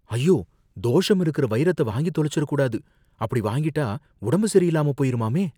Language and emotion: Tamil, fearful